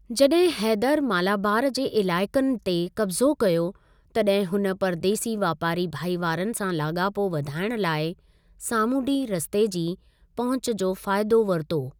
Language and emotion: Sindhi, neutral